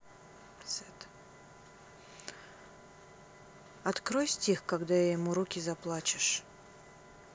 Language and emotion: Russian, sad